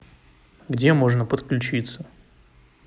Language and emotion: Russian, neutral